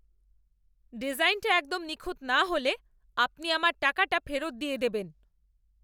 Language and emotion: Bengali, angry